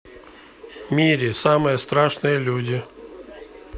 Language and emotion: Russian, neutral